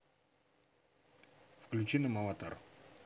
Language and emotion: Russian, neutral